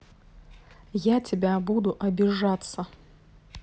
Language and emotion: Russian, angry